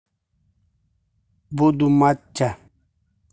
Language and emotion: Russian, neutral